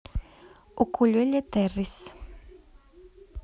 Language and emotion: Russian, neutral